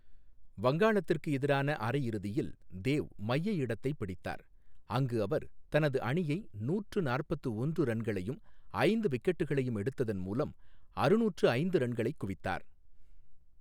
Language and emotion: Tamil, neutral